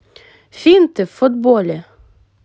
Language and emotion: Russian, positive